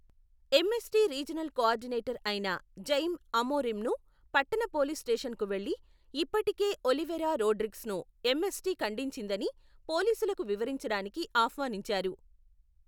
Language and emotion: Telugu, neutral